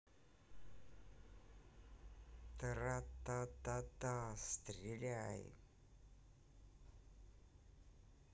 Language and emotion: Russian, neutral